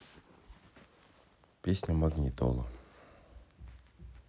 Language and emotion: Russian, neutral